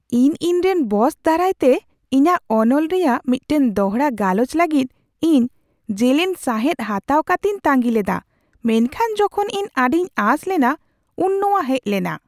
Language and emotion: Santali, surprised